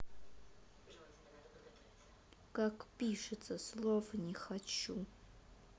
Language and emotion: Russian, neutral